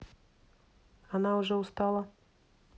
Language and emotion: Russian, neutral